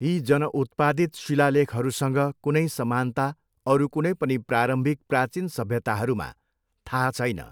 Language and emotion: Nepali, neutral